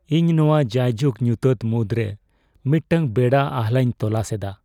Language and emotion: Santali, sad